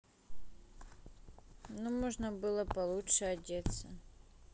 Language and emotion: Russian, neutral